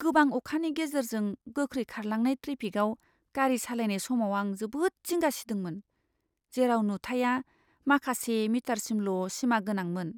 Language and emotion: Bodo, fearful